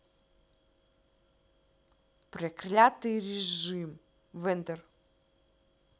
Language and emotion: Russian, angry